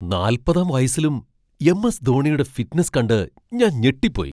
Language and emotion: Malayalam, surprised